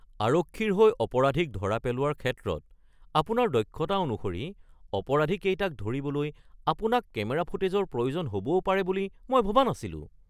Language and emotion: Assamese, surprised